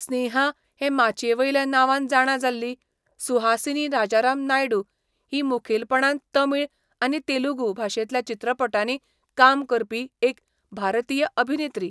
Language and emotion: Goan Konkani, neutral